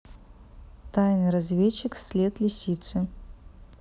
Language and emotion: Russian, neutral